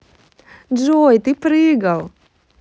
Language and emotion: Russian, positive